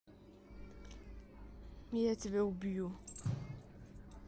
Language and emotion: Russian, neutral